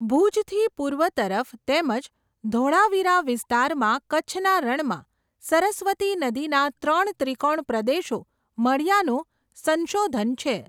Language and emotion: Gujarati, neutral